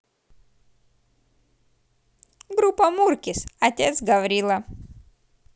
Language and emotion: Russian, positive